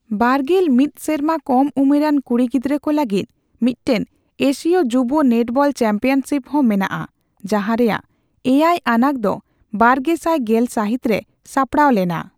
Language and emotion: Santali, neutral